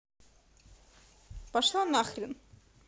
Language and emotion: Russian, angry